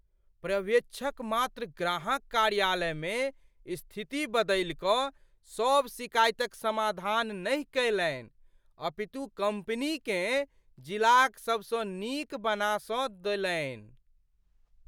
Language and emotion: Maithili, surprised